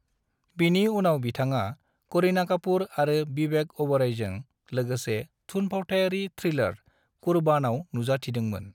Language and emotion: Bodo, neutral